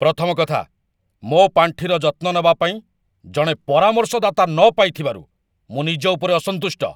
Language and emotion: Odia, angry